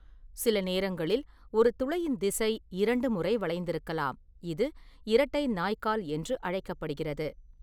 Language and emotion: Tamil, neutral